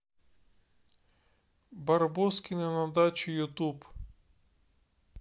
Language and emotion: Russian, neutral